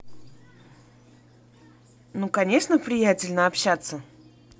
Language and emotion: Russian, positive